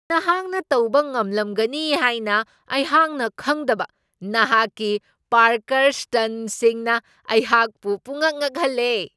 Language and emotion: Manipuri, surprised